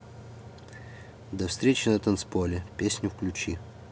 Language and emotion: Russian, neutral